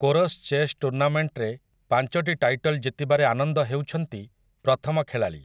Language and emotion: Odia, neutral